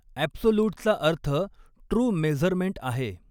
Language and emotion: Marathi, neutral